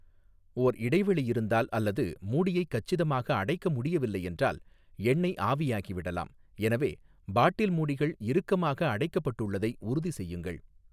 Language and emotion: Tamil, neutral